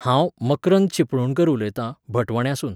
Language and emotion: Goan Konkani, neutral